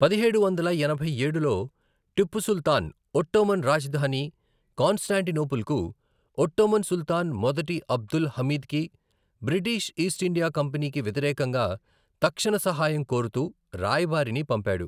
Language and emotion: Telugu, neutral